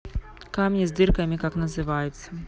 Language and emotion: Russian, neutral